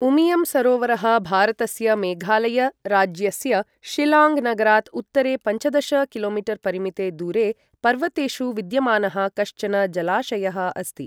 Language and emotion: Sanskrit, neutral